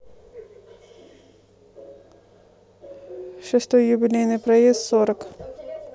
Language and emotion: Russian, neutral